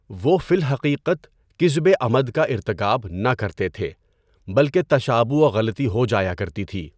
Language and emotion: Urdu, neutral